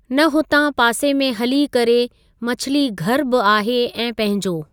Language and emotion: Sindhi, neutral